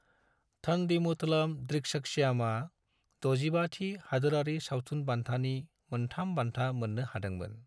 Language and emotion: Bodo, neutral